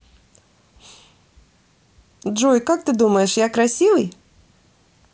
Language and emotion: Russian, positive